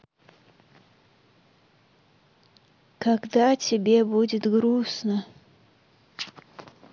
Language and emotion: Russian, sad